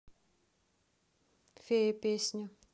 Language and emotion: Russian, neutral